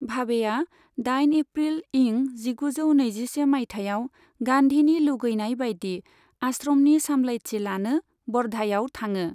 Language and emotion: Bodo, neutral